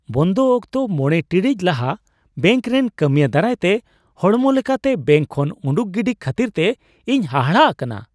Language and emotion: Santali, surprised